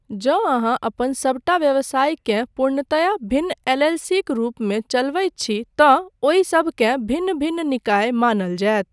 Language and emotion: Maithili, neutral